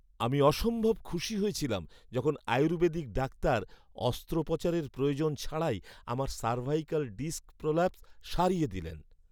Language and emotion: Bengali, happy